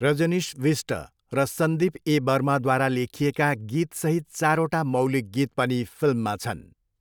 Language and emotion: Nepali, neutral